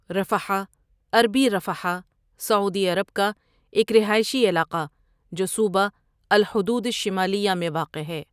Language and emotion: Urdu, neutral